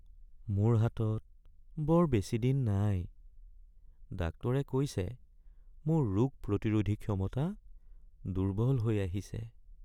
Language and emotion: Assamese, sad